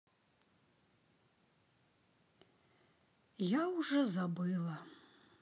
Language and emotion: Russian, sad